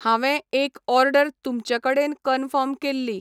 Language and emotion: Goan Konkani, neutral